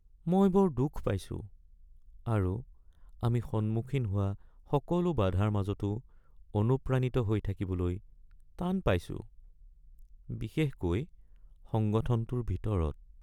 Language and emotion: Assamese, sad